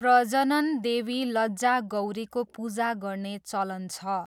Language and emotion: Nepali, neutral